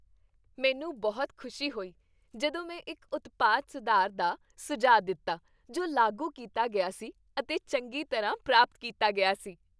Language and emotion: Punjabi, happy